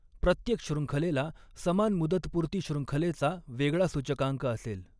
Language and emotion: Marathi, neutral